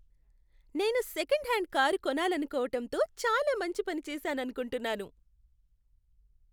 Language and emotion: Telugu, happy